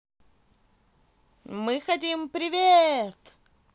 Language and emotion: Russian, positive